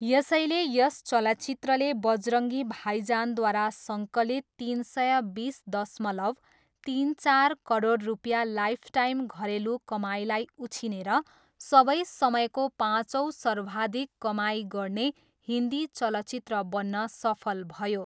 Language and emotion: Nepali, neutral